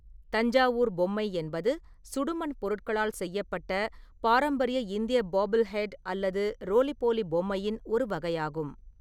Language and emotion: Tamil, neutral